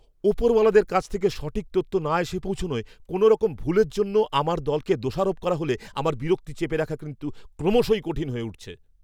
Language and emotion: Bengali, angry